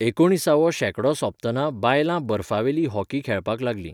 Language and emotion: Goan Konkani, neutral